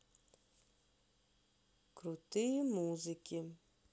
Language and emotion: Russian, sad